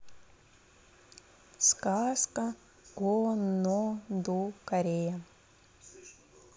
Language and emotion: Russian, neutral